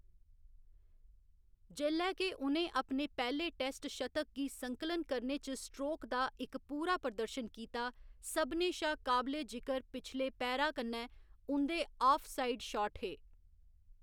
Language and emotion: Dogri, neutral